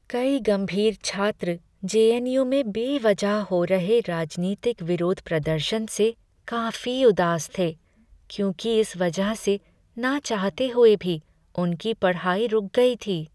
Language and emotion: Hindi, sad